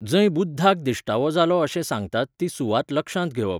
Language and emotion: Goan Konkani, neutral